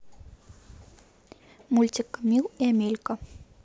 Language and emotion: Russian, neutral